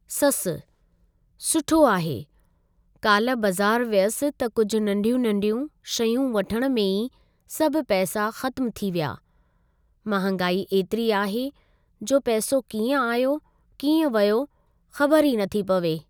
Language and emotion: Sindhi, neutral